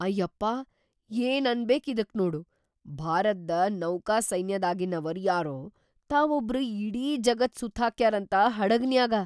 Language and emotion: Kannada, surprised